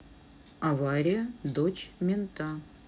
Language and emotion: Russian, neutral